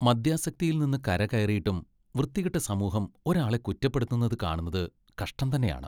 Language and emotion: Malayalam, disgusted